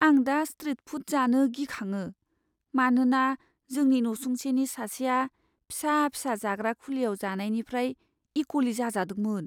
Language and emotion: Bodo, fearful